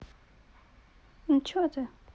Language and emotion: Russian, neutral